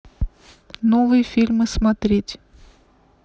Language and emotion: Russian, neutral